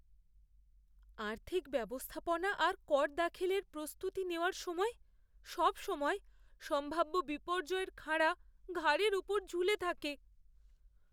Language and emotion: Bengali, fearful